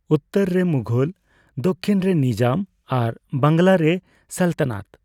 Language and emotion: Santali, neutral